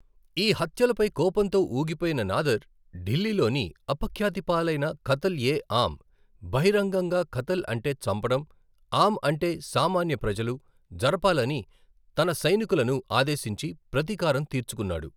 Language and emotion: Telugu, neutral